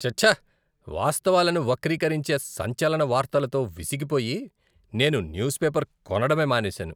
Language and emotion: Telugu, disgusted